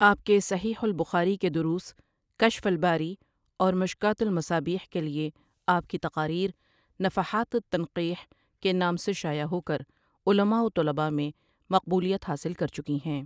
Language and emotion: Urdu, neutral